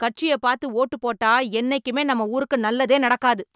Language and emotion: Tamil, angry